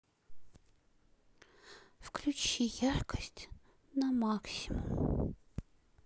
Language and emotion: Russian, sad